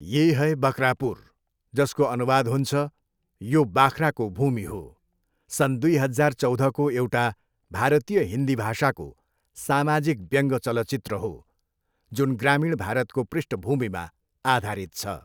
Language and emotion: Nepali, neutral